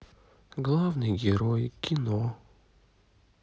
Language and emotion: Russian, sad